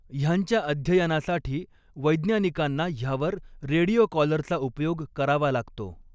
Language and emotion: Marathi, neutral